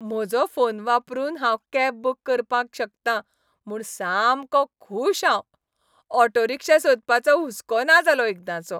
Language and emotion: Goan Konkani, happy